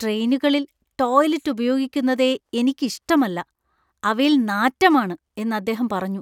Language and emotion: Malayalam, disgusted